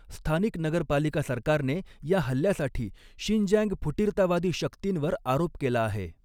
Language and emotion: Marathi, neutral